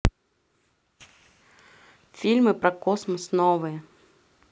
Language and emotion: Russian, neutral